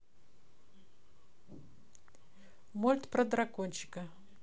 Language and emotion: Russian, neutral